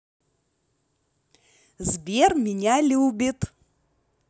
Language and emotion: Russian, positive